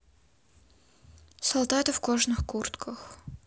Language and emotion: Russian, neutral